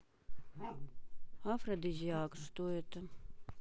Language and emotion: Russian, neutral